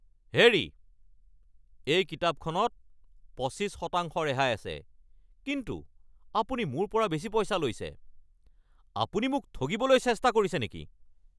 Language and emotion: Assamese, angry